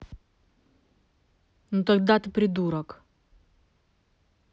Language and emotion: Russian, angry